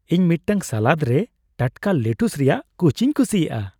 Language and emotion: Santali, happy